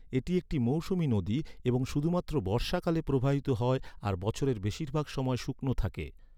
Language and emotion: Bengali, neutral